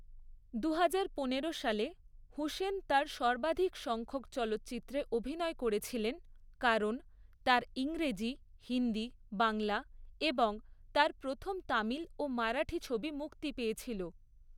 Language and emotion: Bengali, neutral